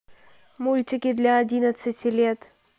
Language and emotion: Russian, neutral